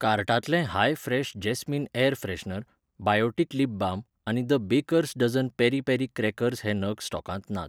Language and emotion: Goan Konkani, neutral